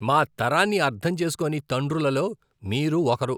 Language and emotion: Telugu, disgusted